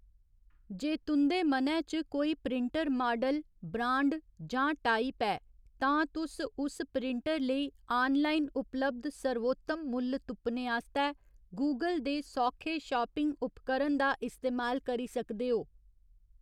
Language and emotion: Dogri, neutral